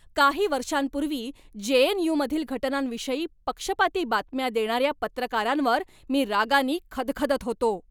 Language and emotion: Marathi, angry